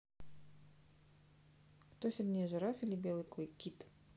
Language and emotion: Russian, neutral